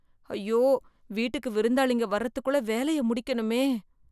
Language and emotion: Tamil, fearful